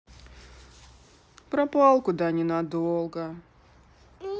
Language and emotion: Russian, sad